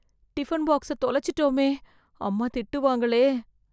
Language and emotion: Tamil, fearful